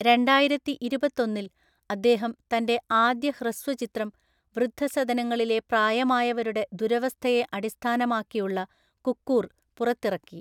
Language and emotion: Malayalam, neutral